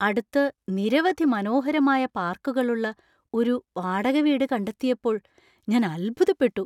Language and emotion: Malayalam, surprised